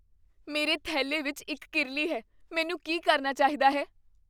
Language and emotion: Punjabi, fearful